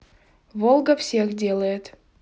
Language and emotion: Russian, neutral